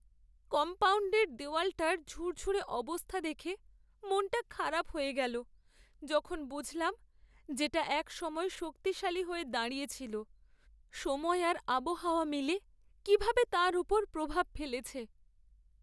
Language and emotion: Bengali, sad